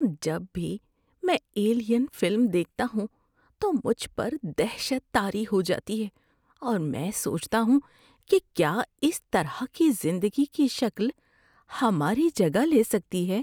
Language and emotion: Urdu, fearful